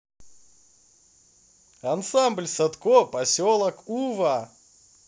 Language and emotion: Russian, positive